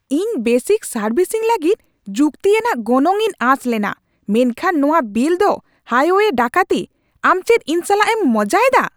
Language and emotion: Santali, angry